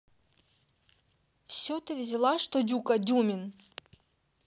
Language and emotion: Russian, angry